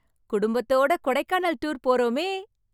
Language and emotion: Tamil, happy